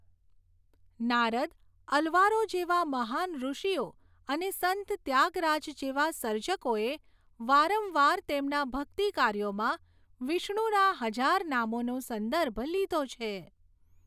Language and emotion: Gujarati, neutral